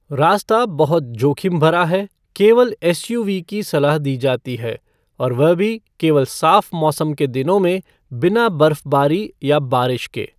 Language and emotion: Hindi, neutral